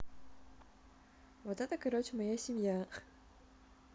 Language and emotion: Russian, neutral